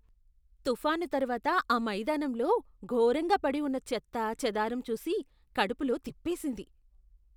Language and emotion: Telugu, disgusted